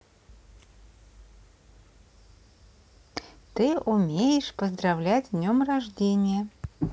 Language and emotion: Russian, positive